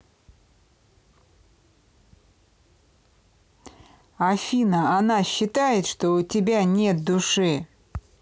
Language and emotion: Russian, neutral